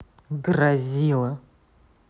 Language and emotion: Russian, angry